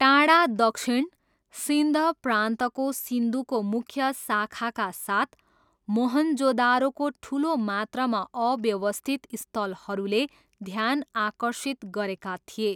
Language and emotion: Nepali, neutral